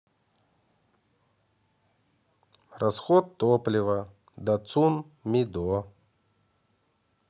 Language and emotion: Russian, neutral